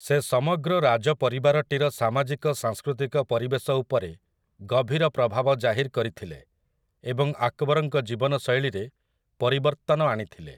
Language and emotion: Odia, neutral